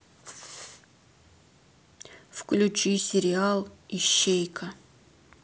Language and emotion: Russian, neutral